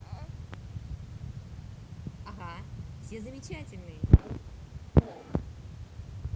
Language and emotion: Russian, positive